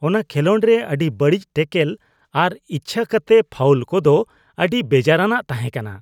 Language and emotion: Santali, disgusted